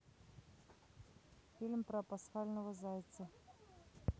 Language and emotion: Russian, neutral